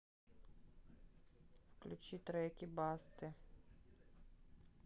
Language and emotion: Russian, neutral